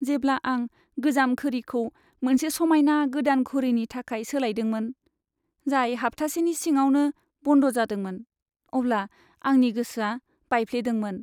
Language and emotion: Bodo, sad